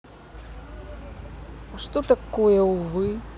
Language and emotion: Russian, neutral